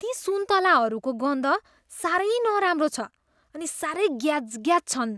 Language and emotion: Nepali, disgusted